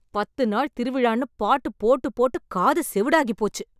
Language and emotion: Tamil, angry